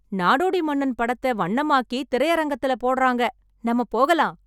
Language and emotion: Tamil, happy